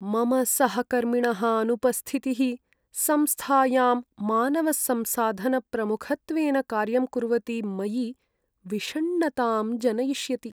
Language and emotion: Sanskrit, sad